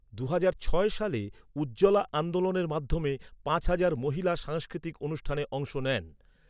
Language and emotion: Bengali, neutral